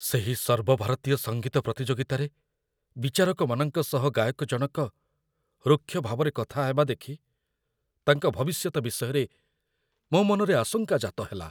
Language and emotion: Odia, fearful